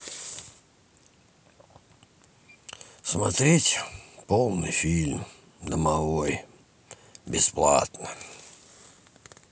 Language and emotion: Russian, neutral